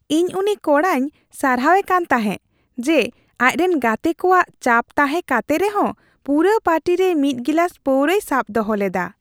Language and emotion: Santali, happy